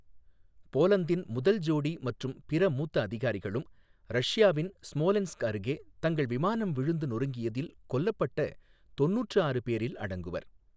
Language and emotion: Tamil, neutral